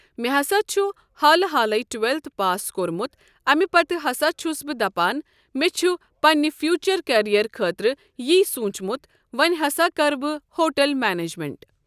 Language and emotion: Kashmiri, neutral